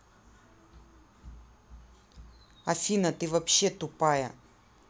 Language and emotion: Russian, angry